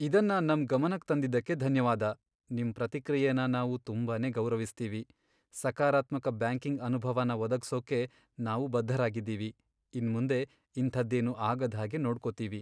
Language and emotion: Kannada, sad